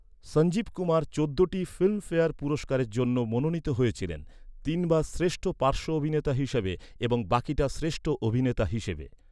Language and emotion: Bengali, neutral